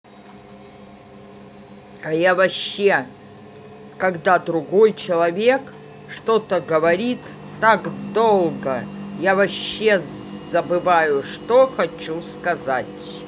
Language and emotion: Russian, angry